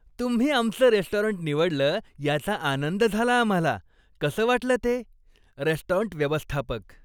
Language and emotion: Marathi, happy